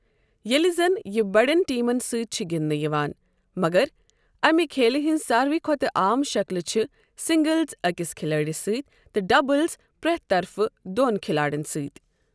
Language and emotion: Kashmiri, neutral